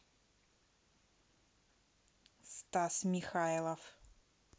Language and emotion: Russian, neutral